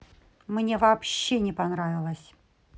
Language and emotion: Russian, angry